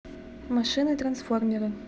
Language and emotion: Russian, neutral